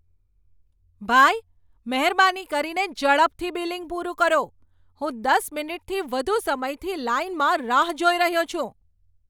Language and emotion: Gujarati, angry